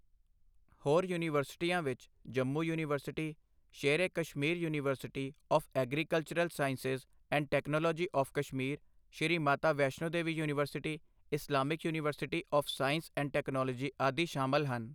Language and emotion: Punjabi, neutral